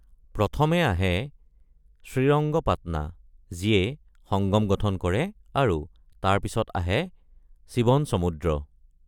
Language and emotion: Assamese, neutral